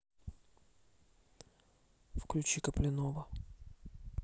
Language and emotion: Russian, neutral